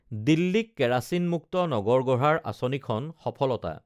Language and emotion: Assamese, neutral